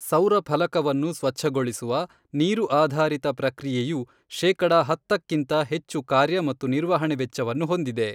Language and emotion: Kannada, neutral